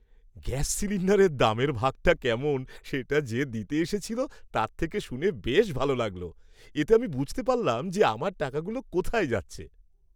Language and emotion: Bengali, happy